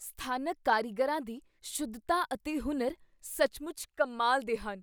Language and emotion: Punjabi, surprised